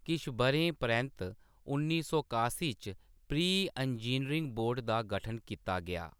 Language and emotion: Dogri, neutral